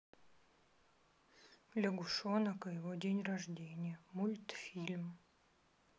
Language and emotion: Russian, neutral